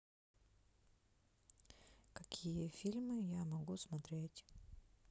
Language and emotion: Russian, sad